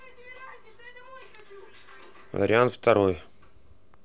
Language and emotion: Russian, neutral